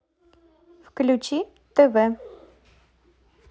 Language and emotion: Russian, positive